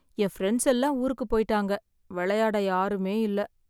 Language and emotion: Tamil, sad